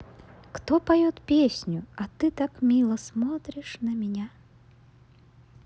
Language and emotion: Russian, positive